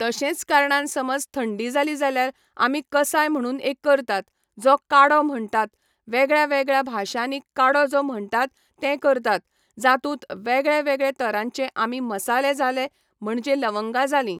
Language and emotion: Goan Konkani, neutral